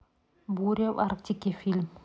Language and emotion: Russian, neutral